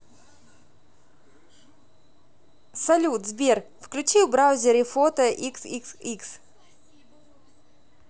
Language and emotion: Russian, positive